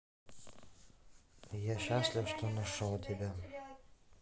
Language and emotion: Russian, neutral